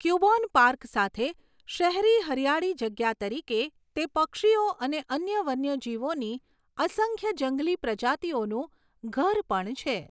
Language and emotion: Gujarati, neutral